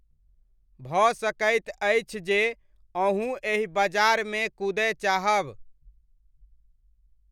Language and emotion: Maithili, neutral